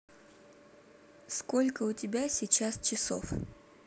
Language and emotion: Russian, neutral